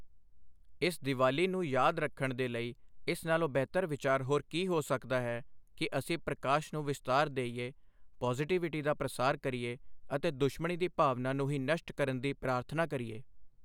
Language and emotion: Punjabi, neutral